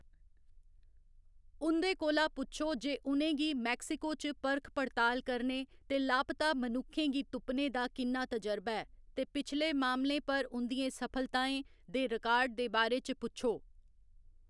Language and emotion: Dogri, neutral